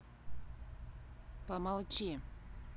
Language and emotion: Russian, angry